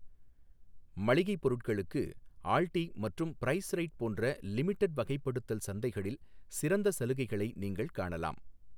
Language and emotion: Tamil, neutral